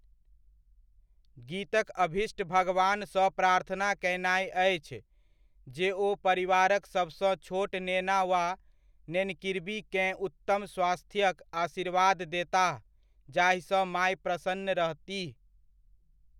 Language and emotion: Maithili, neutral